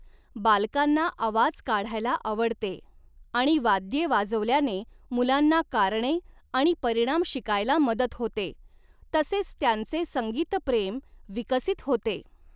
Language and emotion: Marathi, neutral